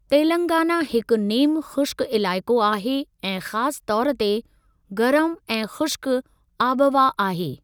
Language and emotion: Sindhi, neutral